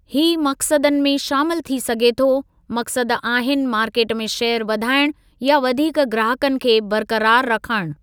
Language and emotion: Sindhi, neutral